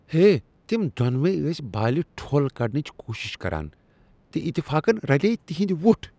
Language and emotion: Kashmiri, disgusted